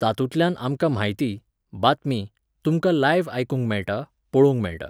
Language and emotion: Goan Konkani, neutral